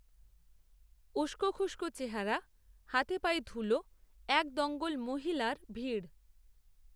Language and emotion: Bengali, neutral